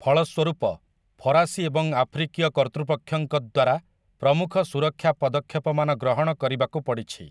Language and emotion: Odia, neutral